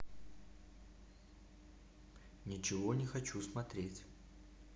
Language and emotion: Russian, neutral